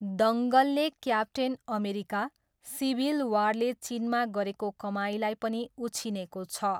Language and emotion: Nepali, neutral